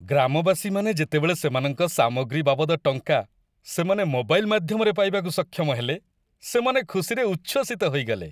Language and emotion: Odia, happy